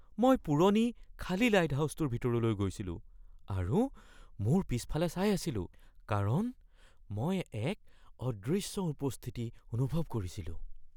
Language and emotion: Assamese, fearful